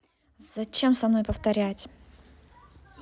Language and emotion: Russian, angry